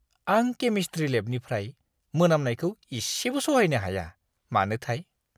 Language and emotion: Bodo, disgusted